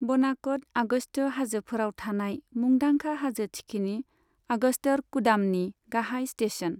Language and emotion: Bodo, neutral